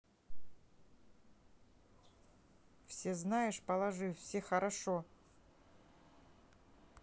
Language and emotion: Russian, neutral